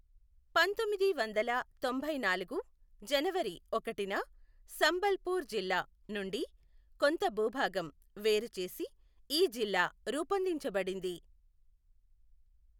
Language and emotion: Telugu, neutral